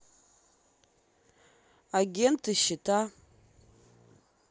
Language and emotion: Russian, neutral